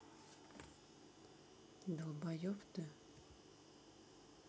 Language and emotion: Russian, neutral